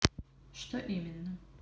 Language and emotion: Russian, neutral